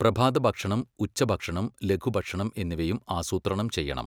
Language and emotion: Malayalam, neutral